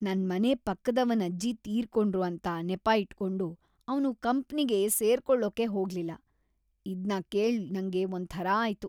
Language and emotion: Kannada, disgusted